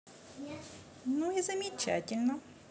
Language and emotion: Russian, positive